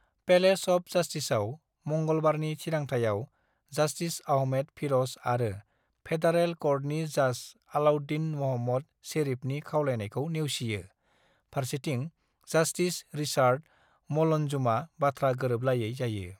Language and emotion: Bodo, neutral